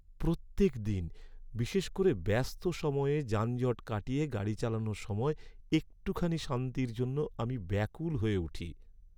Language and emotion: Bengali, sad